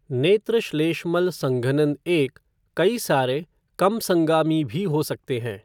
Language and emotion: Hindi, neutral